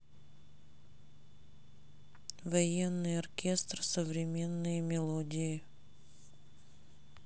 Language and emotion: Russian, neutral